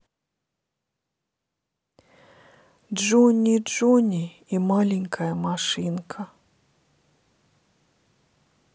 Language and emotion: Russian, sad